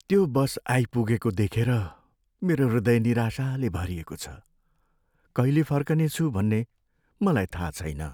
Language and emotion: Nepali, sad